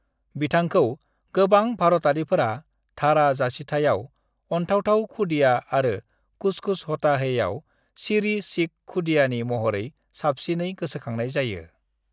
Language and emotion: Bodo, neutral